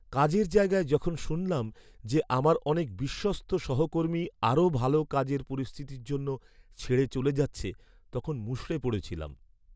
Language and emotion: Bengali, sad